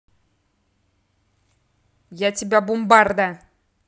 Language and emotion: Russian, angry